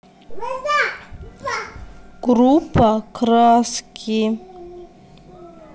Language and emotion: Russian, neutral